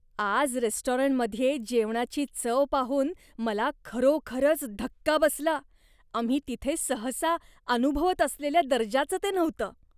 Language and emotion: Marathi, disgusted